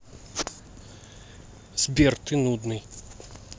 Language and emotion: Russian, angry